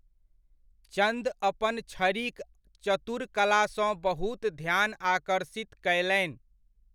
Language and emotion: Maithili, neutral